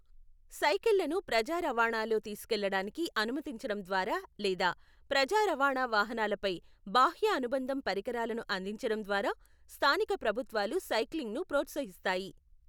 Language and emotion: Telugu, neutral